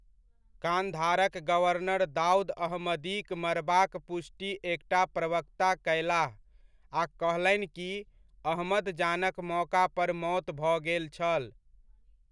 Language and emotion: Maithili, neutral